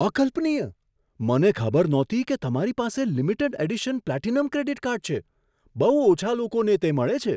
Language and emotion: Gujarati, surprised